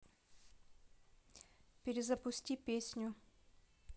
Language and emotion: Russian, neutral